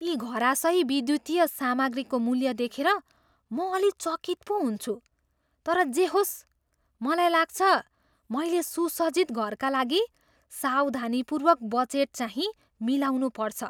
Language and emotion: Nepali, surprised